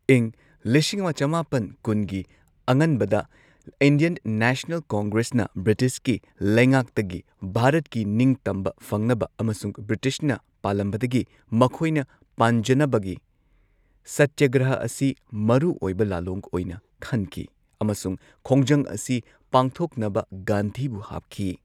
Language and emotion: Manipuri, neutral